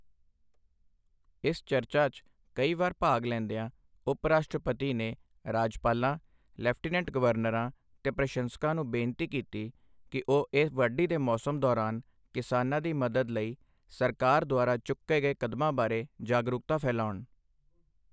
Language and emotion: Punjabi, neutral